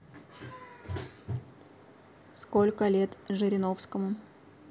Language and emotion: Russian, neutral